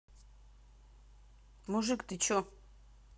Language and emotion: Russian, neutral